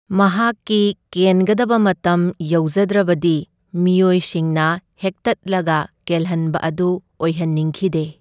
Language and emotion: Manipuri, neutral